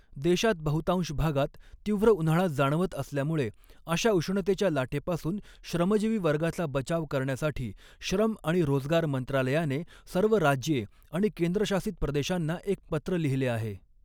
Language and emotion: Marathi, neutral